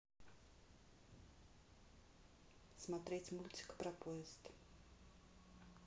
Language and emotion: Russian, neutral